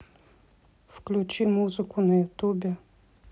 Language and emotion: Russian, neutral